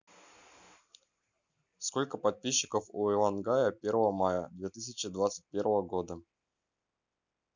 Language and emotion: Russian, neutral